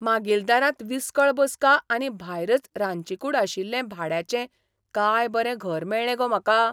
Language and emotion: Goan Konkani, surprised